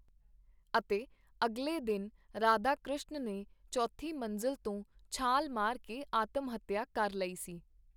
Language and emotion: Punjabi, neutral